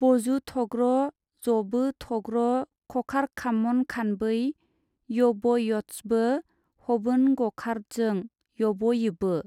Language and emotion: Bodo, neutral